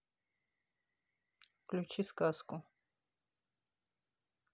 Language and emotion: Russian, neutral